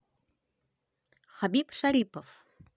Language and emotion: Russian, positive